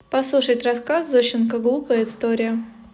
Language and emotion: Russian, neutral